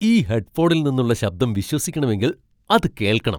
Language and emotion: Malayalam, surprised